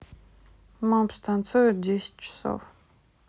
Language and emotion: Russian, neutral